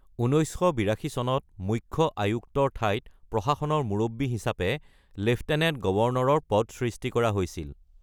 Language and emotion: Assamese, neutral